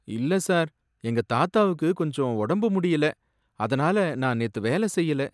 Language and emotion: Tamil, sad